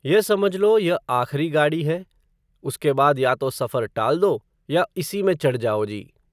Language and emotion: Hindi, neutral